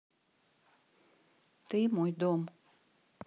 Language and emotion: Russian, neutral